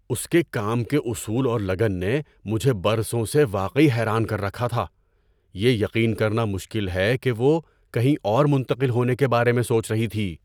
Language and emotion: Urdu, surprised